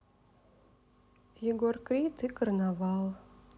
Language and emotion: Russian, sad